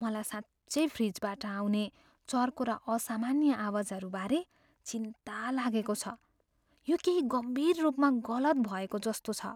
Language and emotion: Nepali, fearful